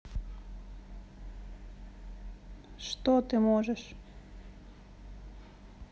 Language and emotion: Russian, sad